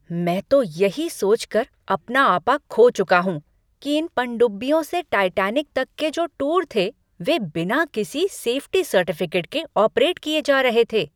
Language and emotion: Hindi, angry